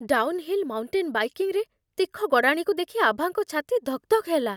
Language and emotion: Odia, fearful